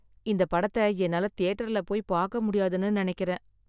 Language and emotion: Tamil, sad